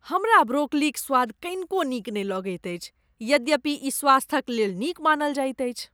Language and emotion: Maithili, disgusted